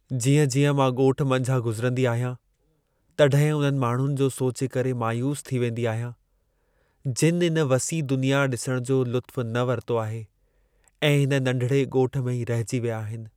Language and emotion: Sindhi, sad